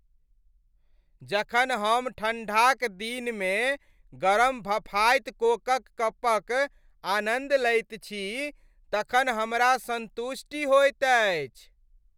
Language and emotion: Maithili, happy